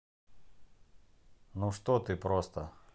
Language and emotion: Russian, neutral